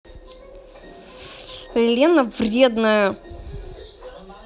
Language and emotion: Russian, angry